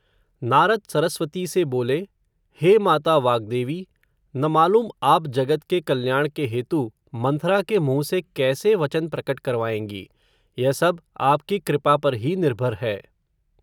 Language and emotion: Hindi, neutral